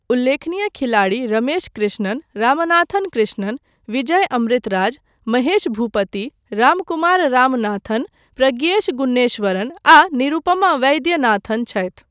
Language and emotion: Maithili, neutral